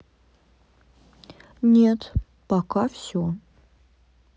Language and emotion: Russian, neutral